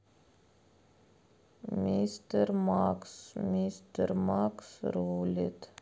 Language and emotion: Russian, sad